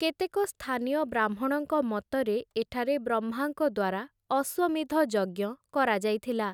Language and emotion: Odia, neutral